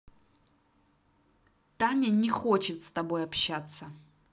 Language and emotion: Russian, angry